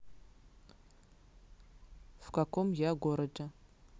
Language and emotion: Russian, neutral